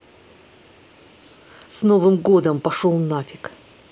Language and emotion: Russian, angry